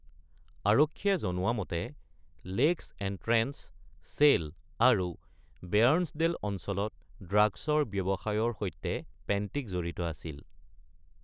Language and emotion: Assamese, neutral